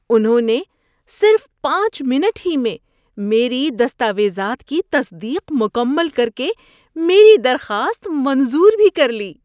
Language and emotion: Urdu, surprised